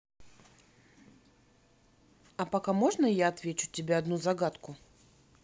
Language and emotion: Russian, neutral